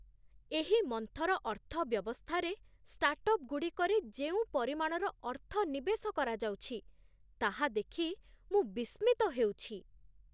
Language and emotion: Odia, surprised